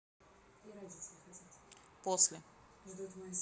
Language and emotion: Russian, neutral